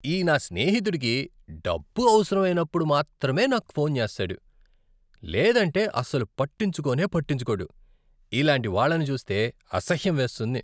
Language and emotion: Telugu, disgusted